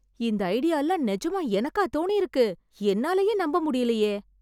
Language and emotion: Tamil, surprised